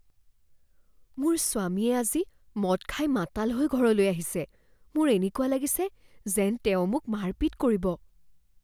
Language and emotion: Assamese, fearful